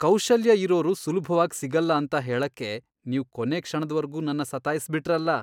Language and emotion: Kannada, disgusted